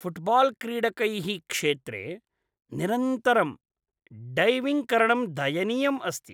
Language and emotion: Sanskrit, disgusted